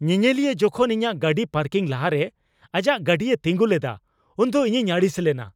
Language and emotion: Santali, angry